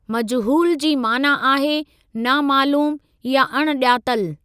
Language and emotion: Sindhi, neutral